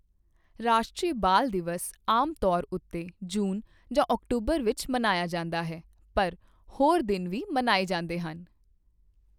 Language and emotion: Punjabi, neutral